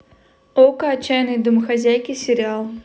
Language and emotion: Russian, neutral